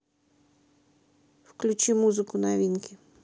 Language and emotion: Russian, neutral